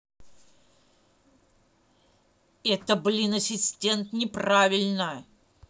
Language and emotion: Russian, angry